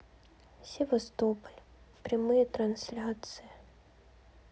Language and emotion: Russian, sad